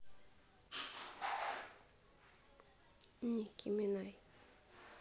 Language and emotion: Russian, neutral